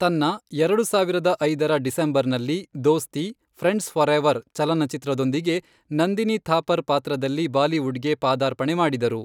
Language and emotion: Kannada, neutral